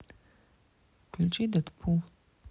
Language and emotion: Russian, neutral